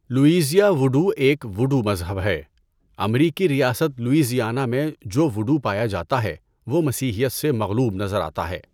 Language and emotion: Urdu, neutral